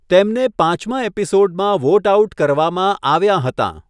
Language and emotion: Gujarati, neutral